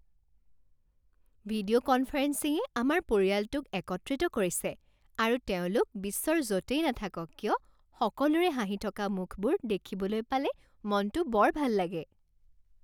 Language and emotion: Assamese, happy